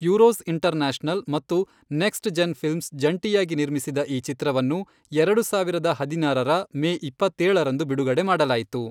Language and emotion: Kannada, neutral